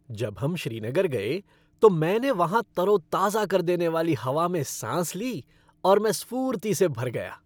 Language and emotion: Hindi, happy